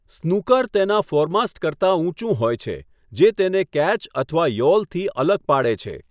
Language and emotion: Gujarati, neutral